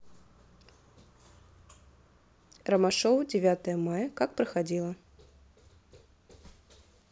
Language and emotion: Russian, neutral